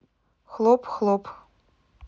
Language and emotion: Russian, neutral